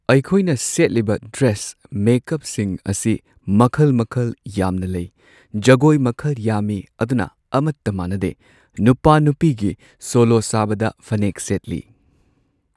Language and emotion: Manipuri, neutral